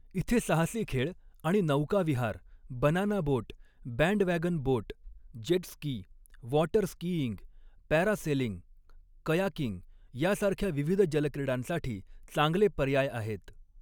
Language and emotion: Marathi, neutral